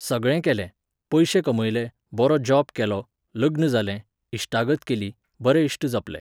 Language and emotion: Goan Konkani, neutral